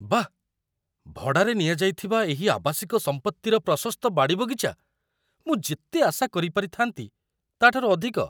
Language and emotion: Odia, surprised